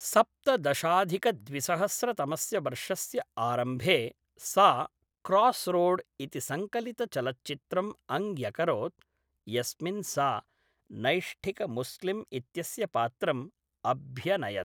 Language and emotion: Sanskrit, neutral